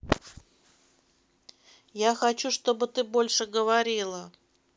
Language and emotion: Russian, neutral